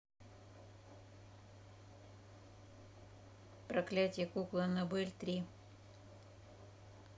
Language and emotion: Russian, neutral